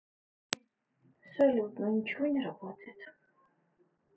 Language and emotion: Russian, sad